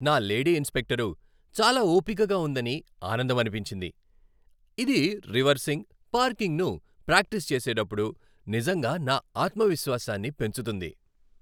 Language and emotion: Telugu, happy